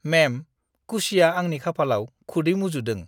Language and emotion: Bodo, disgusted